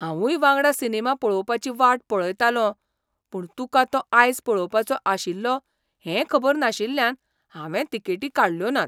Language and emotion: Goan Konkani, surprised